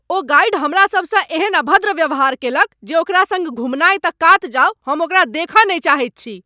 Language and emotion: Maithili, angry